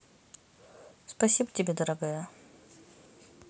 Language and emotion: Russian, positive